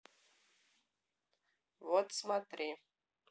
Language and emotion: Russian, neutral